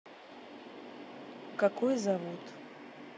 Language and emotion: Russian, neutral